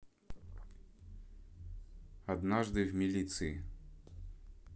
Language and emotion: Russian, neutral